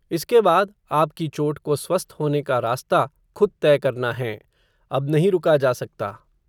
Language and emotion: Hindi, neutral